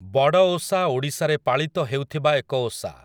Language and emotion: Odia, neutral